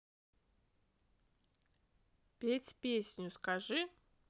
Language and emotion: Russian, positive